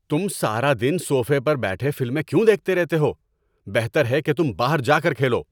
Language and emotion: Urdu, angry